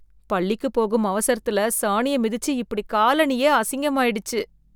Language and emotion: Tamil, disgusted